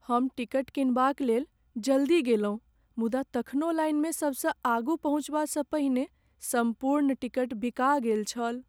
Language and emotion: Maithili, sad